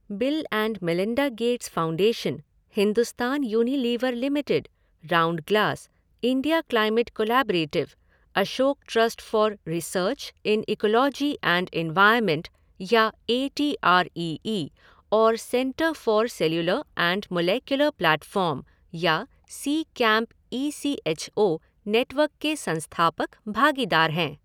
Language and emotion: Hindi, neutral